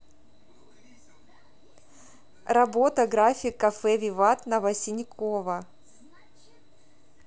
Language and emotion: Russian, neutral